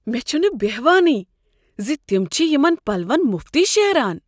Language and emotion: Kashmiri, surprised